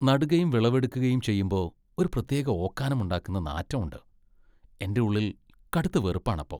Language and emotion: Malayalam, disgusted